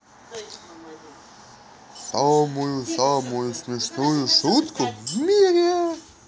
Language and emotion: Russian, positive